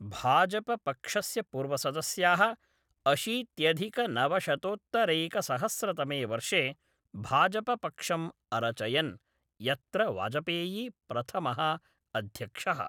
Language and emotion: Sanskrit, neutral